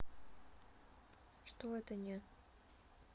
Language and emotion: Russian, neutral